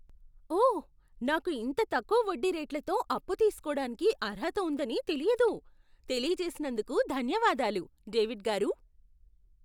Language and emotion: Telugu, surprised